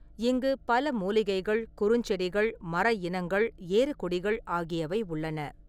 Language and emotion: Tamil, neutral